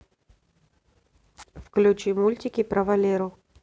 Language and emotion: Russian, neutral